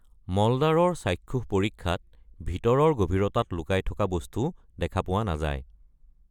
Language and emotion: Assamese, neutral